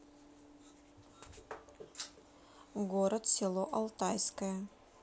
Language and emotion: Russian, neutral